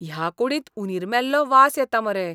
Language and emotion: Goan Konkani, disgusted